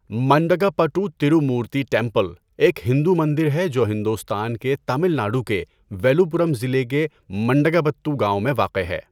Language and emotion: Urdu, neutral